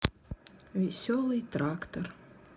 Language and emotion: Russian, sad